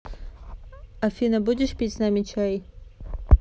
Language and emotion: Russian, neutral